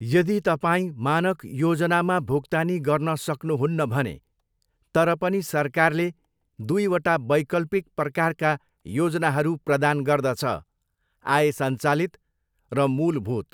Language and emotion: Nepali, neutral